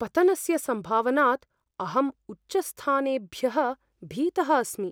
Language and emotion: Sanskrit, fearful